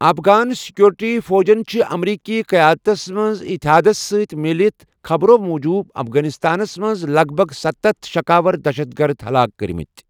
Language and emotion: Kashmiri, neutral